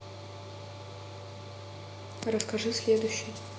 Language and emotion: Russian, neutral